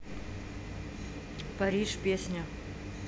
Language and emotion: Russian, neutral